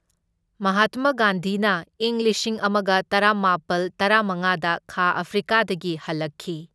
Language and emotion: Manipuri, neutral